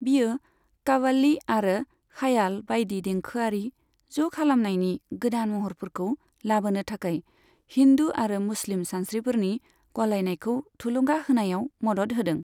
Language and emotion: Bodo, neutral